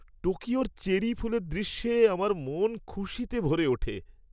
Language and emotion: Bengali, happy